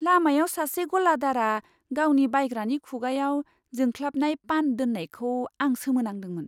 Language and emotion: Bodo, surprised